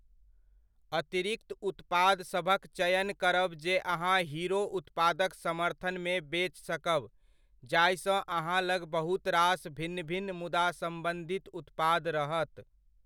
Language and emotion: Maithili, neutral